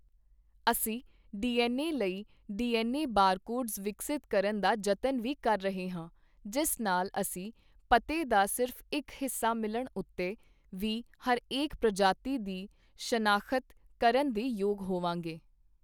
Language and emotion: Punjabi, neutral